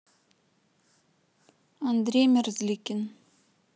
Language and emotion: Russian, neutral